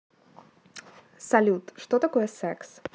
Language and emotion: Russian, neutral